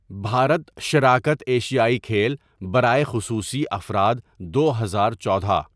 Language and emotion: Urdu, neutral